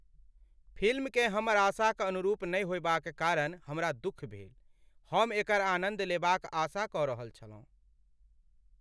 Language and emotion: Maithili, sad